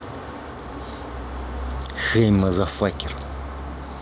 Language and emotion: Russian, neutral